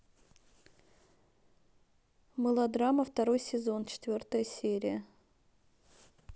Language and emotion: Russian, neutral